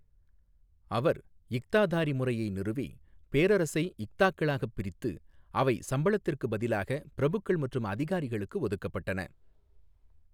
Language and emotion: Tamil, neutral